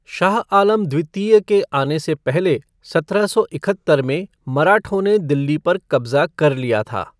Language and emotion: Hindi, neutral